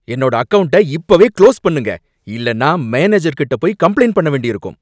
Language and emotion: Tamil, angry